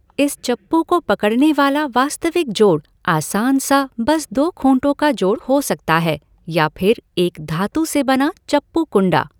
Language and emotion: Hindi, neutral